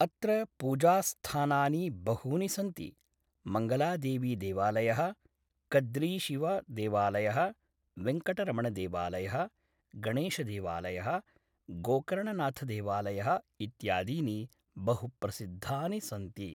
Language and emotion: Sanskrit, neutral